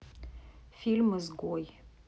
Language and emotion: Russian, neutral